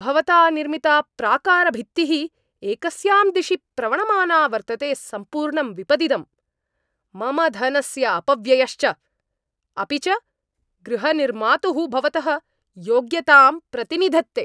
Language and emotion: Sanskrit, angry